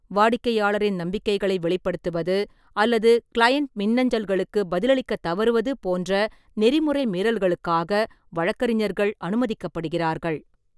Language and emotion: Tamil, neutral